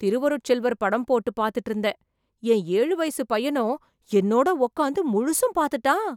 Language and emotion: Tamil, surprised